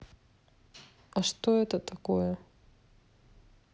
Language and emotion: Russian, neutral